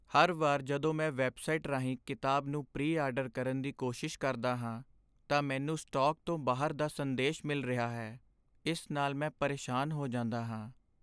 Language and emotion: Punjabi, sad